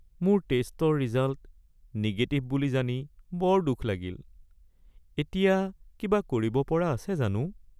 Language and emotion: Assamese, sad